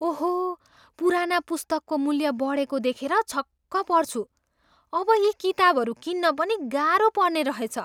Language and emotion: Nepali, surprised